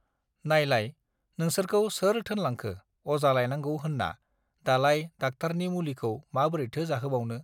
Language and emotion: Bodo, neutral